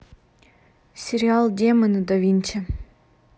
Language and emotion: Russian, neutral